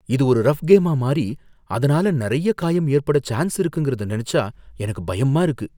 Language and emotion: Tamil, fearful